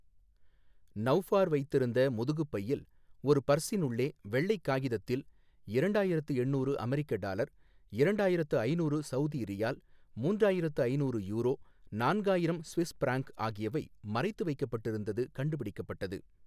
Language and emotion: Tamil, neutral